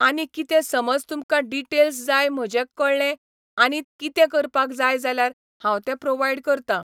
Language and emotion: Goan Konkani, neutral